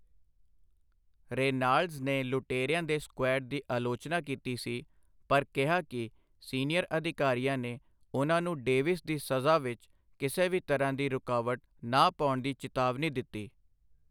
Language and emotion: Punjabi, neutral